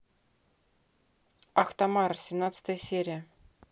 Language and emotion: Russian, neutral